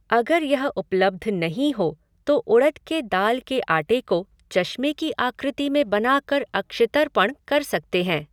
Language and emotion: Hindi, neutral